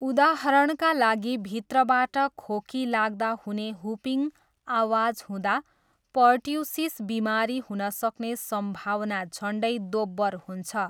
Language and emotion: Nepali, neutral